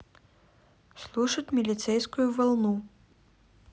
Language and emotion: Russian, neutral